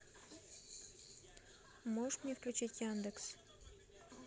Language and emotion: Russian, neutral